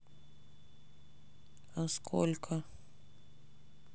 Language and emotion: Russian, sad